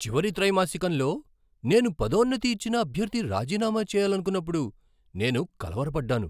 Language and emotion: Telugu, surprised